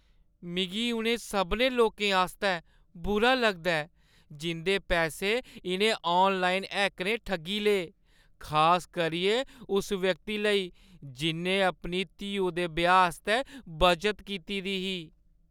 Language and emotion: Dogri, sad